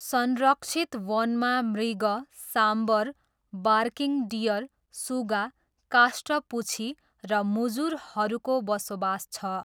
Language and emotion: Nepali, neutral